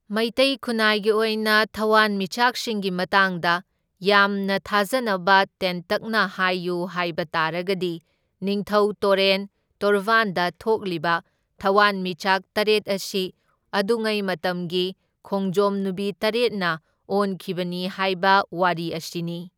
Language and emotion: Manipuri, neutral